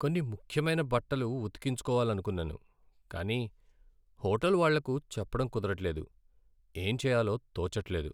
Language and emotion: Telugu, sad